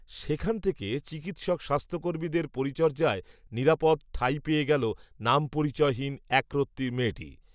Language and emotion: Bengali, neutral